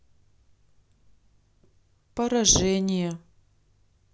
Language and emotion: Russian, sad